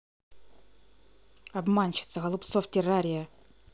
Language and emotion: Russian, angry